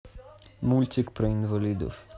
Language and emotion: Russian, neutral